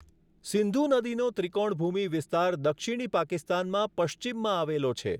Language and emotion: Gujarati, neutral